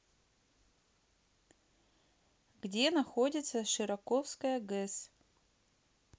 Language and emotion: Russian, neutral